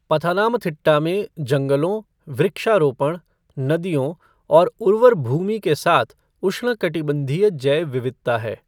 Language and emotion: Hindi, neutral